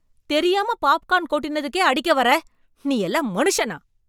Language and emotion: Tamil, angry